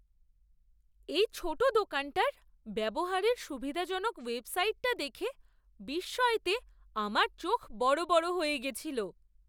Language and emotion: Bengali, surprised